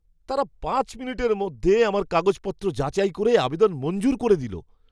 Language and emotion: Bengali, surprised